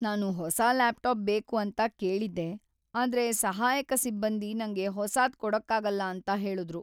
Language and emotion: Kannada, sad